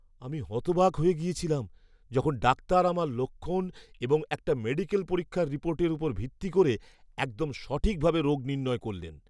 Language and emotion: Bengali, surprised